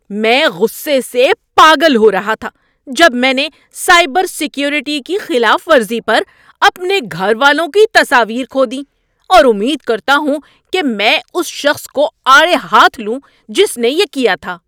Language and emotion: Urdu, angry